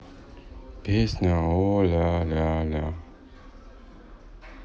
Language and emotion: Russian, sad